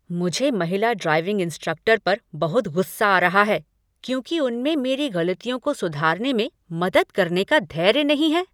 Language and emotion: Hindi, angry